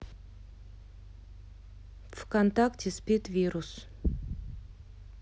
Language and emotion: Russian, neutral